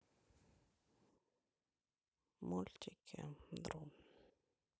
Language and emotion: Russian, sad